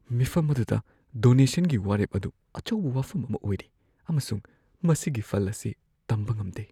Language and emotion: Manipuri, fearful